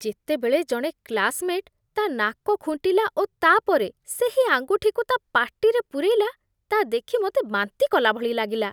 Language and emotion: Odia, disgusted